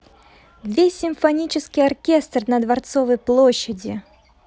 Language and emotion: Russian, positive